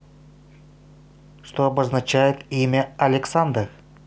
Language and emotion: Russian, positive